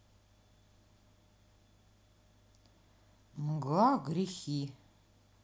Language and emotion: Russian, neutral